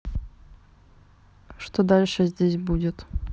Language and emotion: Russian, neutral